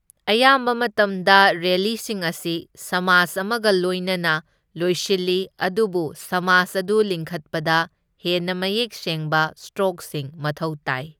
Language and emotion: Manipuri, neutral